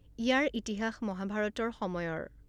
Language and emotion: Assamese, neutral